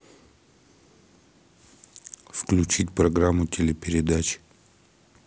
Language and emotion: Russian, neutral